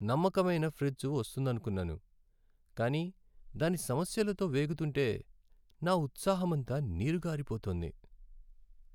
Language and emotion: Telugu, sad